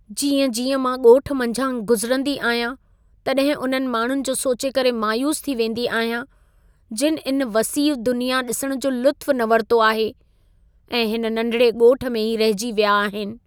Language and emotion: Sindhi, sad